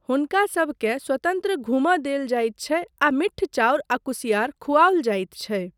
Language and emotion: Maithili, neutral